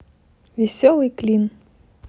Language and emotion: Russian, positive